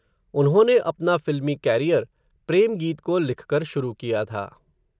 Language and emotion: Hindi, neutral